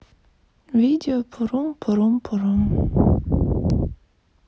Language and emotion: Russian, sad